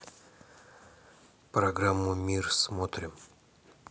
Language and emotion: Russian, neutral